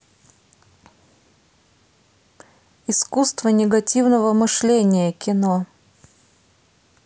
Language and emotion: Russian, neutral